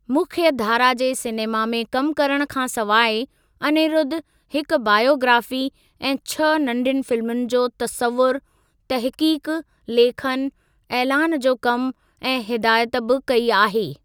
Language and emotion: Sindhi, neutral